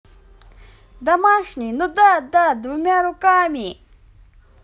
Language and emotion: Russian, positive